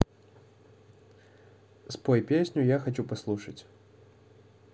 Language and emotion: Russian, neutral